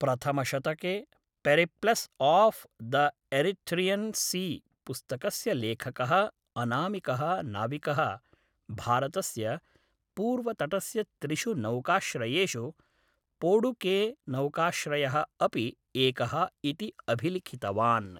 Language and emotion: Sanskrit, neutral